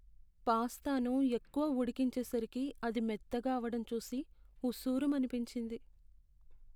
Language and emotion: Telugu, sad